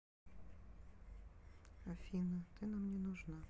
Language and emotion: Russian, sad